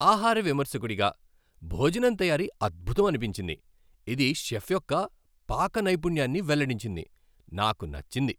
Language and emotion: Telugu, happy